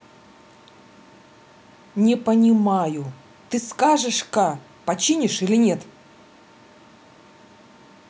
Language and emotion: Russian, angry